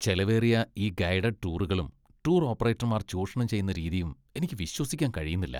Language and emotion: Malayalam, disgusted